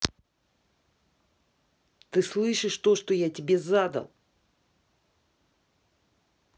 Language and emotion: Russian, angry